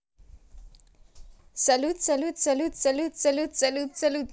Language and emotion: Russian, positive